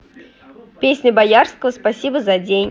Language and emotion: Russian, positive